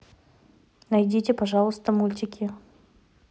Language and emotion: Russian, neutral